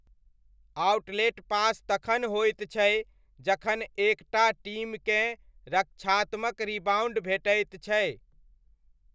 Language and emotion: Maithili, neutral